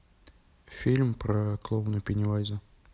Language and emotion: Russian, neutral